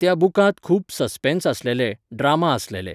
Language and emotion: Goan Konkani, neutral